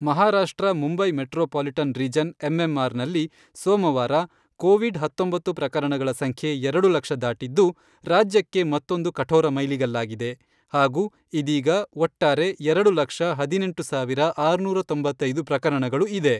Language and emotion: Kannada, neutral